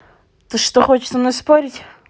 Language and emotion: Russian, angry